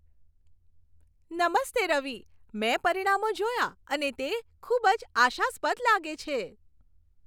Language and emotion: Gujarati, happy